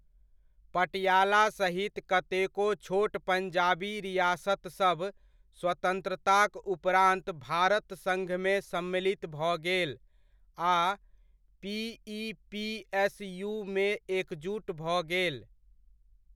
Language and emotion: Maithili, neutral